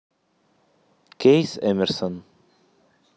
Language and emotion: Russian, neutral